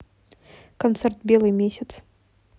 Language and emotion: Russian, neutral